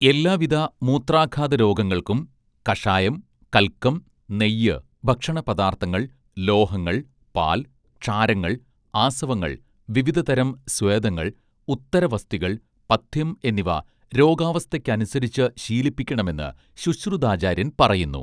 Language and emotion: Malayalam, neutral